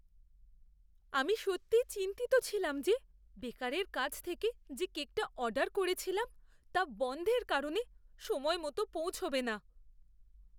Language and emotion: Bengali, fearful